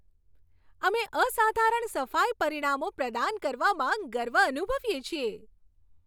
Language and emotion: Gujarati, happy